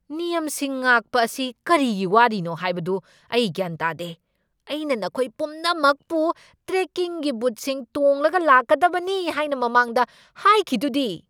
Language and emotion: Manipuri, angry